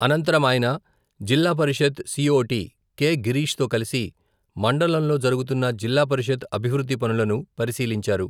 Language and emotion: Telugu, neutral